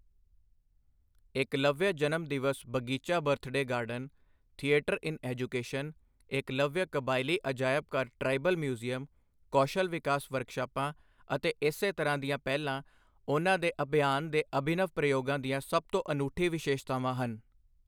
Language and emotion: Punjabi, neutral